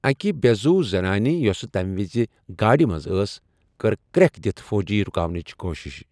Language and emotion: Kashmiri, neutral